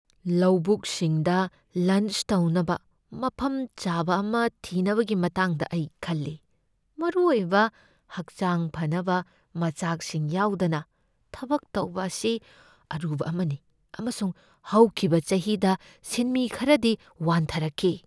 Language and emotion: Manipuri, fearful